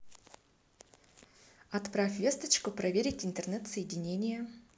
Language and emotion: Russian, positive